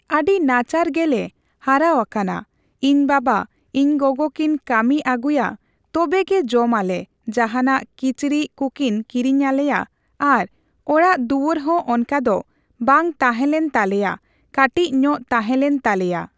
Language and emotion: Santali, neutral